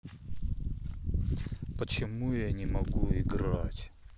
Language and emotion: Russian, sad